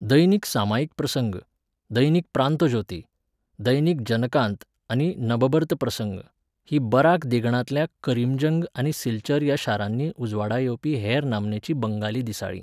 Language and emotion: Goan Konkani, neutral